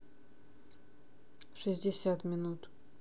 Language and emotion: Russian, neutral